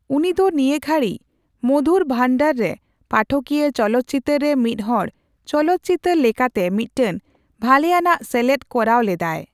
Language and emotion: Santali, neutral